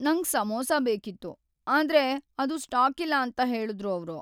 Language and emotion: Kannada, sad